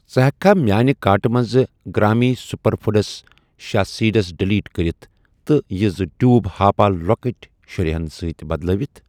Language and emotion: Kashmiri, neutral